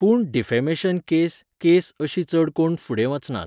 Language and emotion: Goan Konkani, neutral